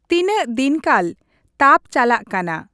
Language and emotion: Santali, neutral